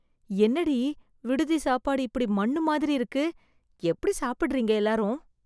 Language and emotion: Tamil, disgusted